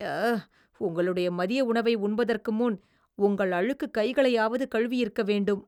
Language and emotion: Tamil, disgusted